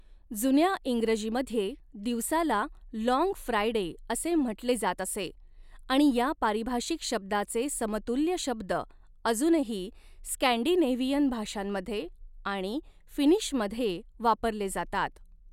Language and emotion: Marathi, neutral